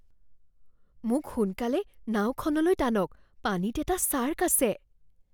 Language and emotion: Assamese, fearful